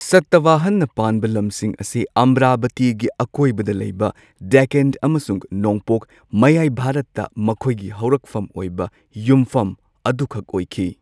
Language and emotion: Manipuri, neutral